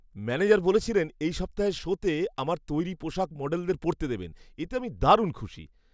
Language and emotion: Bengali, happy